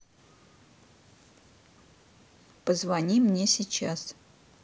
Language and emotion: Russian, neutral